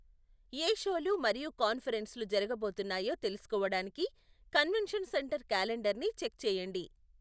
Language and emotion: Telugu, neutral